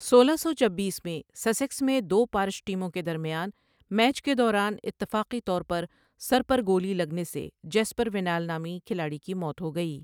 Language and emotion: Urdu, neutral